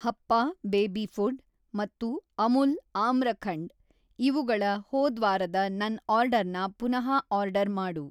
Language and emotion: Kannada, neutral